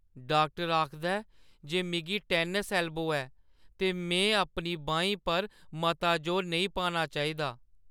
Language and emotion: Dogri, sad